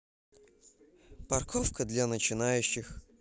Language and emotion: Russian, neutral